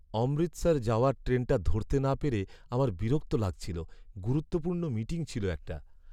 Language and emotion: Bengali, sad